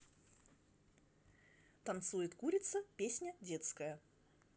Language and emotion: Russian, neutral